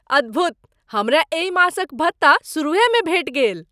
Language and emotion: Maithili, surprised